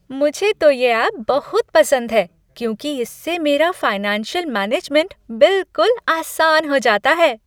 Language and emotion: Hindi, happy